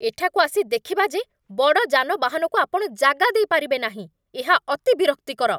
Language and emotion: Odia, angry